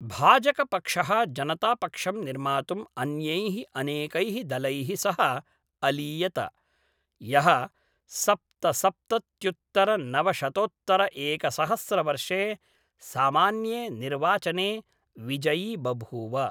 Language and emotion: Sanskrit, neutral